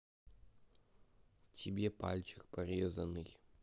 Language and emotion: Russian, neutral